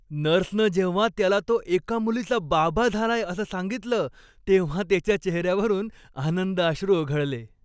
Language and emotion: Marathi, happy